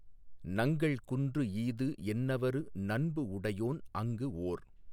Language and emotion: Tamil, neutral